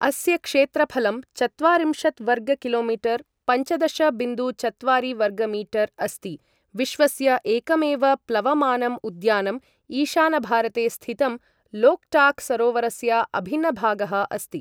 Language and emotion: Sanskrit, neutral